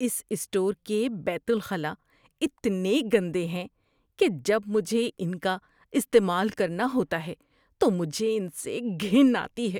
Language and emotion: Urdu, disgusted